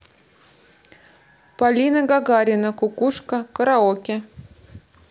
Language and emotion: Russian, neutral